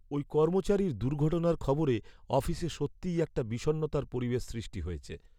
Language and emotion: Bengali, sad